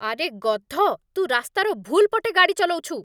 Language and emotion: Odia, angry